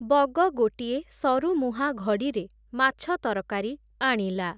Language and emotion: Odia, neutral